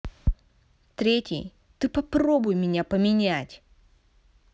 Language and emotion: Russian, angry